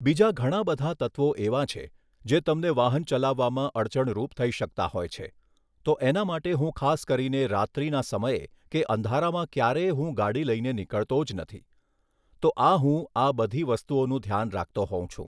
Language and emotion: Gujarati, neutral